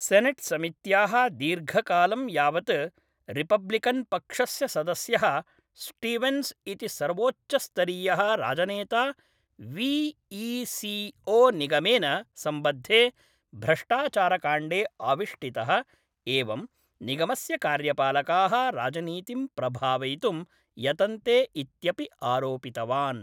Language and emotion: Sanskrit, neutral